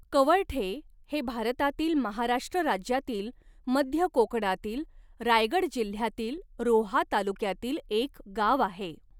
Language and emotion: Marathi, neutral